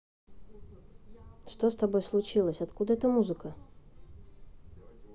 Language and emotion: Russian, neutral